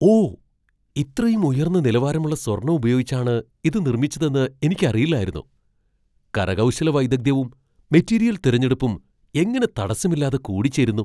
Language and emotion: Malayalam, surprised